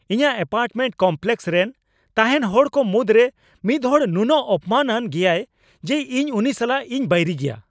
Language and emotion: Santali, angry